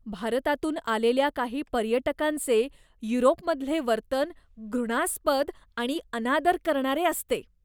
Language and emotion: Marathi, disgusted